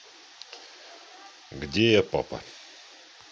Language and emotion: Russian, neutral